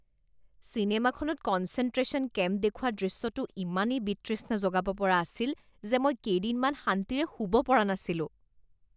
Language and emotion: Assamese, disgusted